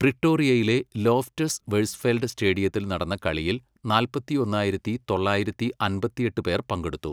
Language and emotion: Malayalam, neutral